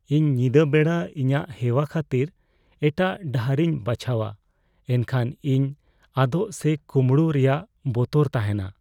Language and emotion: Santali, fearful